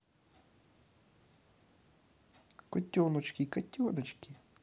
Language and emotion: Russian, positive